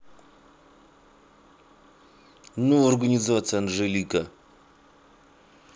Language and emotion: Russian, angry